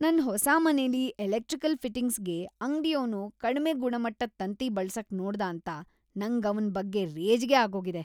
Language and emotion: Kannada, disgusted